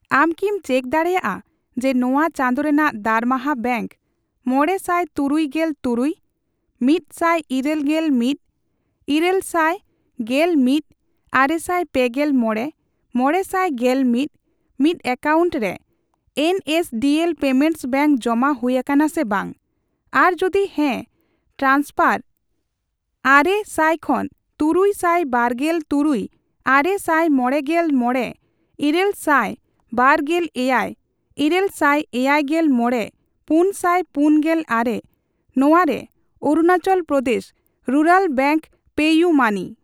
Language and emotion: Santali, neutral